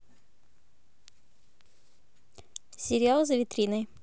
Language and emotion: Russian, neutral